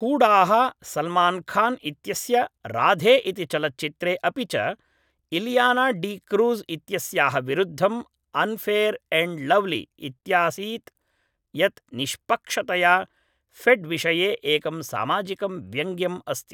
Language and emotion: Sanskrit, neutral